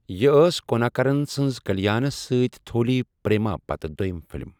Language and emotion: Kashmiri, neutral